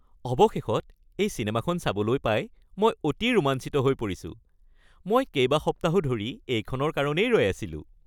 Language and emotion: Assamese, happy